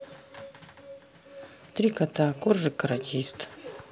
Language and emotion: Russian, neutral